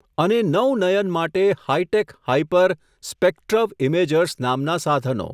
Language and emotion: Gujarati, neutral